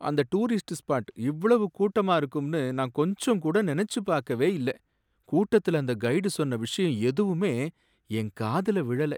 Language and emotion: Tamil, sad